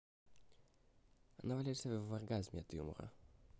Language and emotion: Russian, neutral